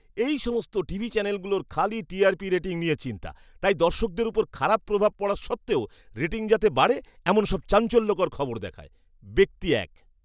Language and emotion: Bengali, disgusted